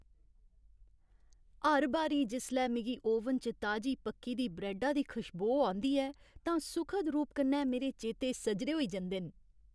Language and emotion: Dogri, happy